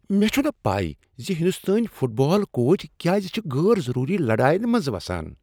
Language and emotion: Kashmiri, disgusted